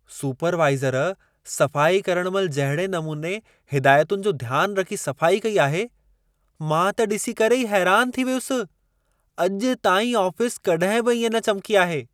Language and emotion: Sindhi, surprised